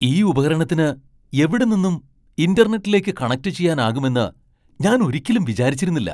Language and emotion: Malayalam, surprised